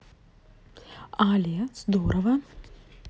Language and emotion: Russian, neutral